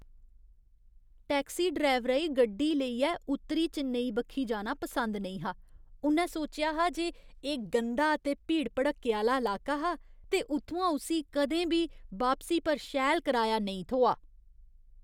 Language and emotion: Dogri, disgusted